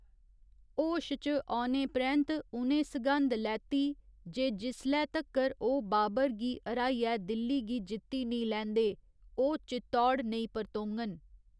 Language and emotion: Dogri, neutral